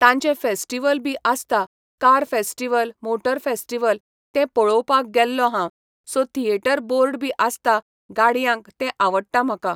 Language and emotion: Goan Konkani, neutral